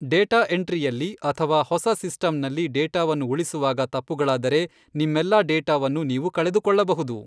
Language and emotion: Kannada, neutral